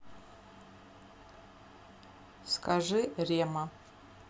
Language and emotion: Russian, neutral